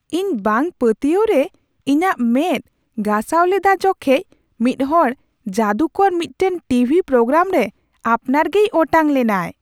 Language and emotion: Santali, surprised